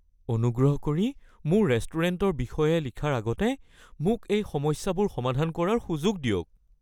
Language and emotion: Assamese, fearful